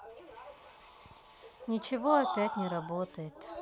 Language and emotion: Russian, sad